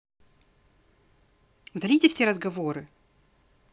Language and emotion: Russian, angry